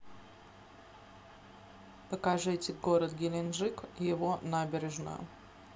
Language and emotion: Russian, neutral